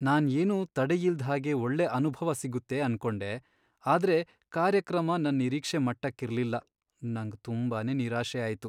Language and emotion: Kannada, sad